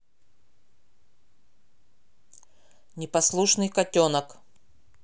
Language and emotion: Russian, angry